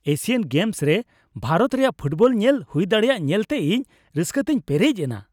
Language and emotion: Santali, happy